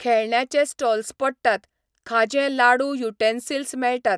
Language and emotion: Goan Konkani, neutral